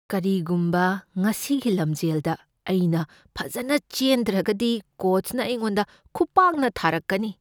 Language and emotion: Manipuri, fearful